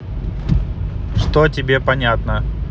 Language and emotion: Russian, neutral